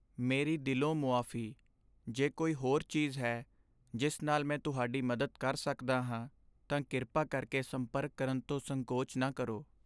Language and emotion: Punjabi, sad